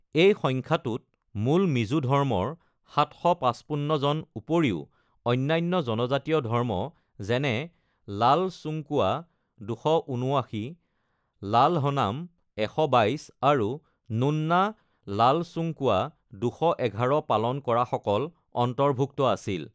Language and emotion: Assamese, neutral